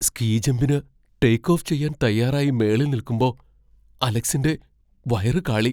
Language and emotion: Malayalam, fearful